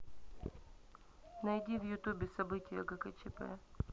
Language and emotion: Russian, neutral